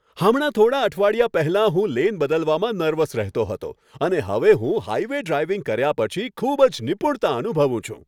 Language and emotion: Gujarati, happy